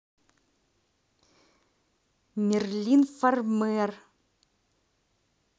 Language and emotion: Russian, neutral